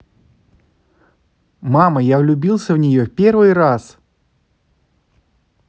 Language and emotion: Russian, positive